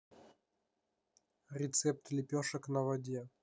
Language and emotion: Russian, neutral